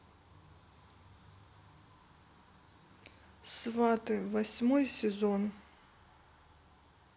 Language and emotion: Russian, neutral